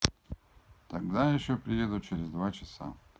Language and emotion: Russian, neutral